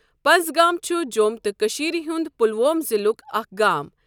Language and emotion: Kashmiri, neutral